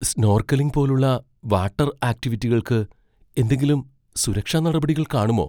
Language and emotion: Malayalam, fearful